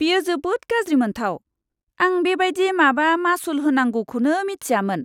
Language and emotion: Bodo, disgusted